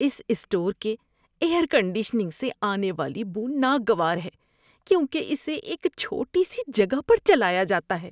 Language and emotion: Urdu, disgusted